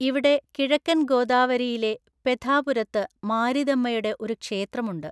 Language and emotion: Malayalam, neutral